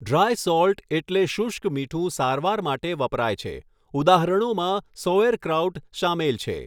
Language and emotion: Gujarati, neutral